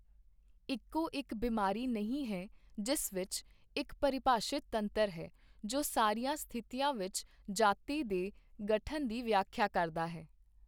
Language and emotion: Punjabi, neutral